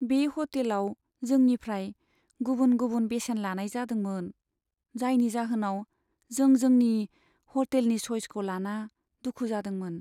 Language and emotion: Bodo, sad